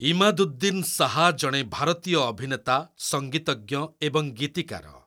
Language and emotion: Odia, neutral